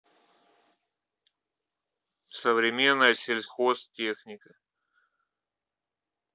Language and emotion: Russian, neutral